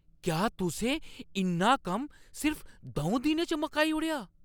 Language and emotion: Dogri, surprised